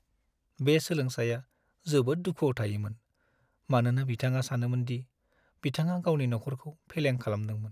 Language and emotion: Bodo, sad